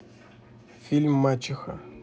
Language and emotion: Russian, neutral